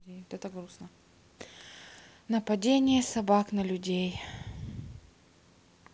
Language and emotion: Russian, sad